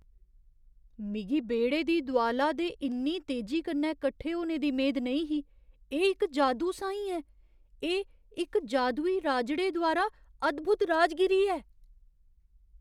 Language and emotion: Dogri, surprised